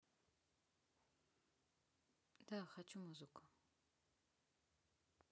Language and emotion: Russian, neutral